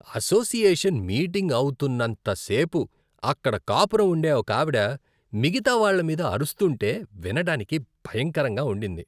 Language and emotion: Telugu, disgusted